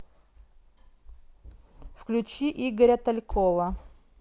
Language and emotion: Russian, neutral